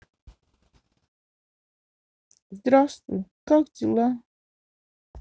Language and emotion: Russian, sad